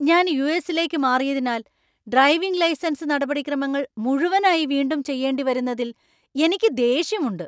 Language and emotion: Malayalam, angry